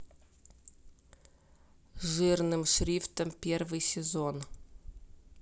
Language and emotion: Russian, neutral